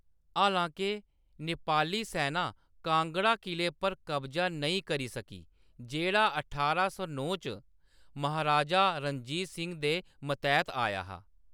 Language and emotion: Dogri, neutral